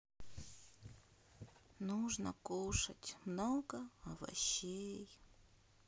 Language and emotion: Russian, sad